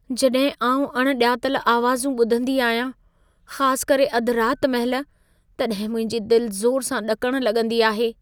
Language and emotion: Sindhi, fearful